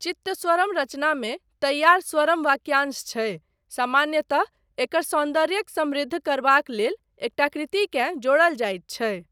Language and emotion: Maithili, neutral